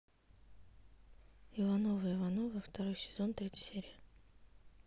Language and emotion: Russian, neutral